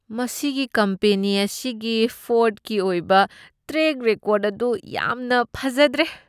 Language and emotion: Manipuri, disgusted